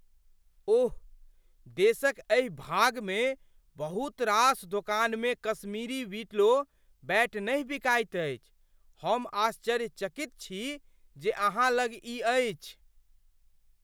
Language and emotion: Maithili, surprised